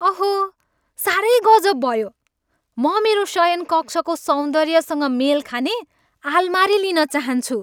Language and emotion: Nepali, happy